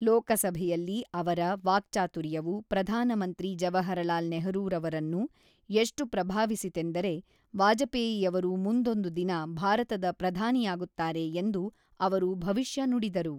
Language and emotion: Kannada, neutral